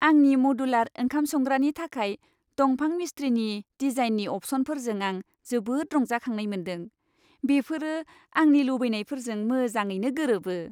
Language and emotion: Bodo, happy